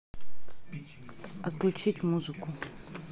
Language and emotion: Russian, neutral